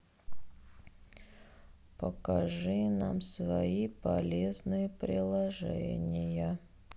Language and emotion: Russian, sad